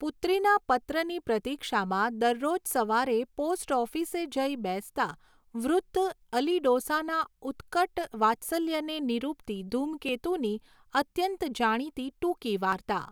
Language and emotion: Gujarati, neutral